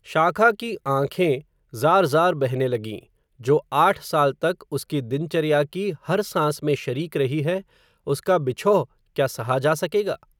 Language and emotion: Hindi, neutral